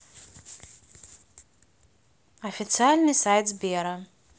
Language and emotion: Russian, neutral